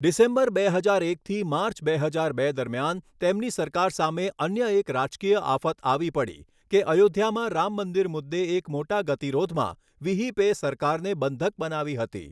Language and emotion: Gujarati, neutral